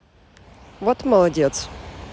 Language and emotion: Russian, neutral